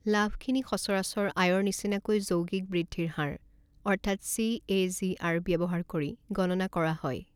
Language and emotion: Assamese, neutral